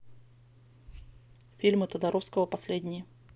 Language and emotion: Russian, neutral